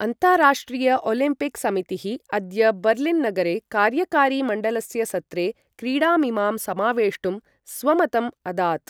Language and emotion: Sanskrit, neutral